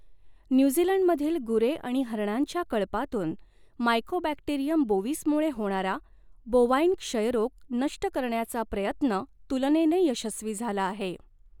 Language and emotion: Marathi, neutral